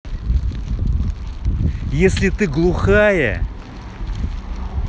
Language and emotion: Russian, angry